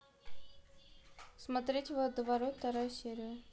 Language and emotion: Russian, neutral